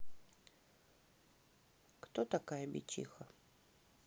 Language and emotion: Russian, neutral